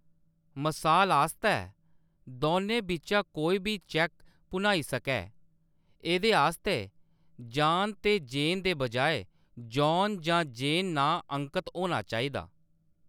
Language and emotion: Dogri, neutral